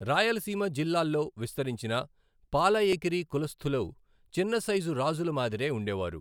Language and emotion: Telugu, neutral